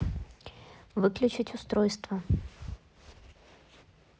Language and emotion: Russian, neutral